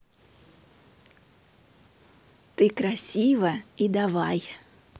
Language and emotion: Russian, positive